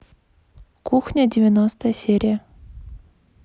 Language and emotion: Russian, neutral